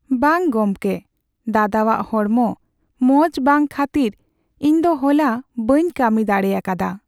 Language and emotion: Santali, sad